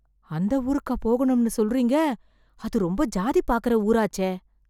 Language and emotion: Tamil, fearful